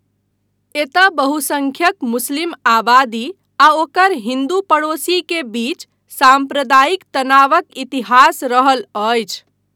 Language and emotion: Maithili, neutral